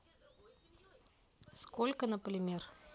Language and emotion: Russian, neutral